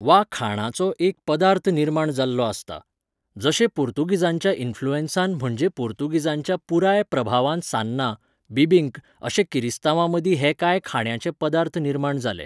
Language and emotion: Goan Konkani, neutral